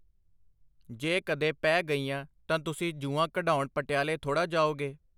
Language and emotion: Punjabi, neutral